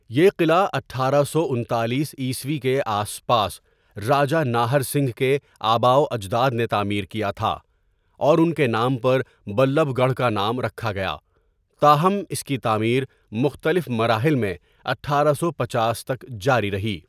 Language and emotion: Urdu, neutral